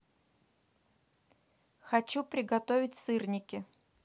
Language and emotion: Russian, neutral